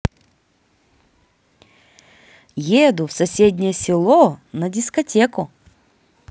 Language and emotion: Russian, positive